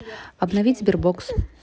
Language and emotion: Russian, neutral